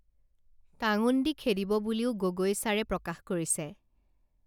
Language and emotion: Assamese, neutral